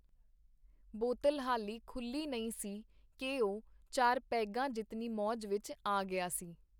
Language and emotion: Punjabi, neutral